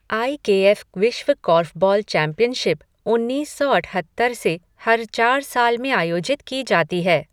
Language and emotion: Hindi, neutral